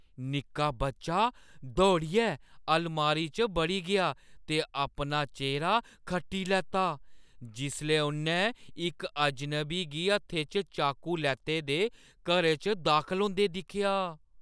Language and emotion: Dogri, fearful